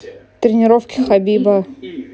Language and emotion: Russian, neutral